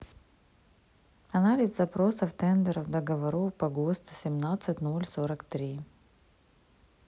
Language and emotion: Russian, neutral